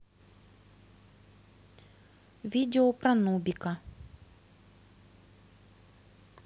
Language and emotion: Russian, neutral